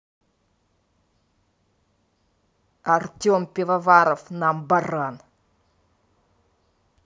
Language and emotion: Russian, angry